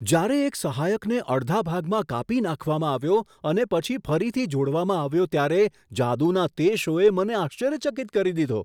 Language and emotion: Gujarati, surprised